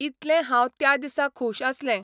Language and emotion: Goan Konkani, neutral